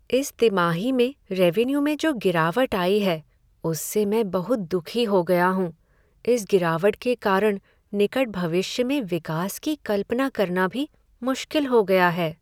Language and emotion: Hindi, sad